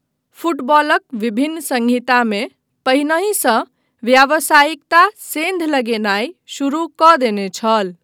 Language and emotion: Maithili, neutral